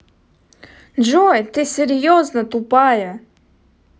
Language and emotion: Russian, angry